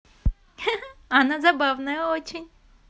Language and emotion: Russian, positive